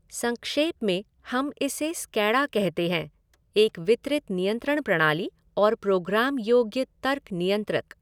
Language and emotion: Hindi, neutral